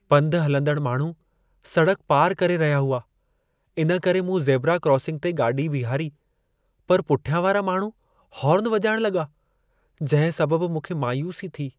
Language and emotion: Sindhi, sad